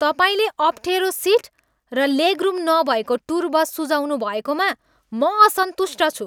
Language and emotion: Nepali, angry